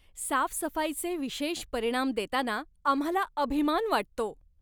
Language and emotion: Marathi, happy